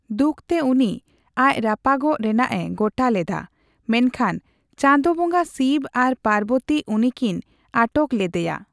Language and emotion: Santali, neutral